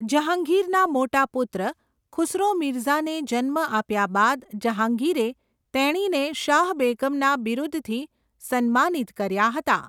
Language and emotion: Gujarati, neutral